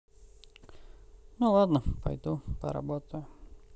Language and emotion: Russian, sad